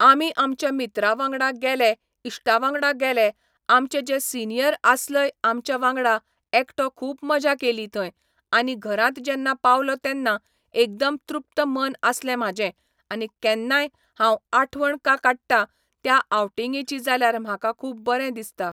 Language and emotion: Goan Konkani, neutral